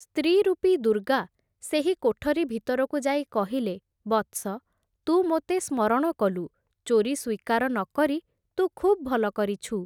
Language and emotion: Odia, neutral